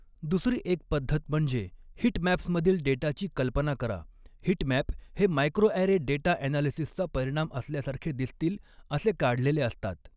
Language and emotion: Marathi, neutral